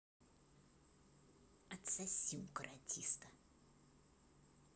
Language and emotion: Russian, angry